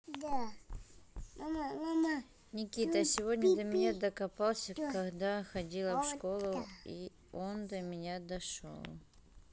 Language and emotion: Russian, neutral